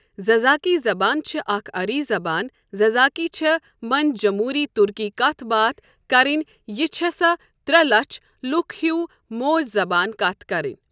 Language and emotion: Kashmiri, neutral